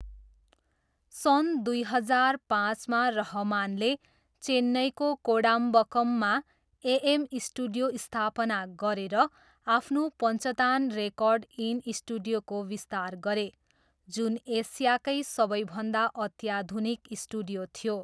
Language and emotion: Nepali, neutral